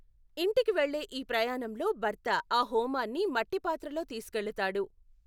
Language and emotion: Telugu, neutral